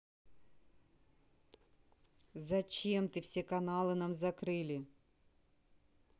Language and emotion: Russian, angry